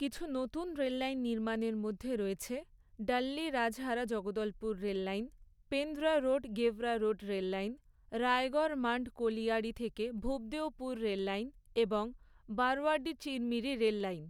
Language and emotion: Bengali, neutral